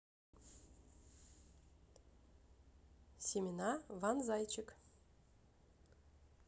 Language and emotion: Russian, neutral